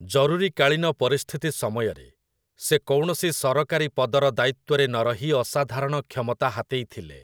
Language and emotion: Odia, neutral